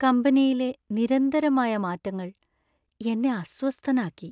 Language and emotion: Malayalam, sad